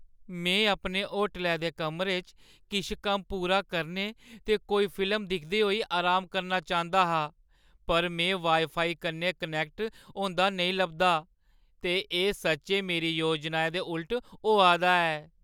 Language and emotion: Dogri, sad